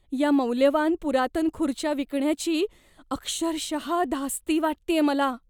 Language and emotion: Marathi, fearful